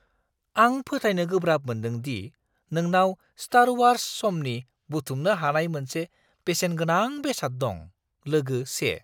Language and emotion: Bodo, surprised